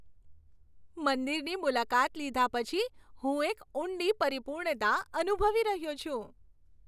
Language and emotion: Gujarati, happy